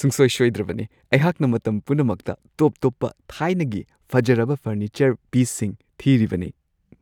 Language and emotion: Manipuri, happy